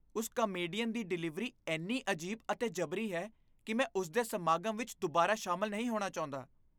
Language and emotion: Punjabi, disgusted